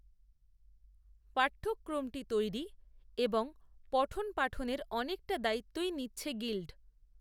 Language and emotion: Bengali, neutral